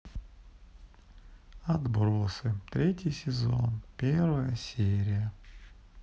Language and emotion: Russian, sad